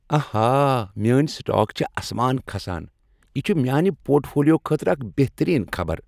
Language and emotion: Kashmiri, happy